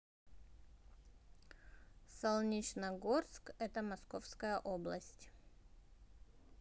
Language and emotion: Russian, neutral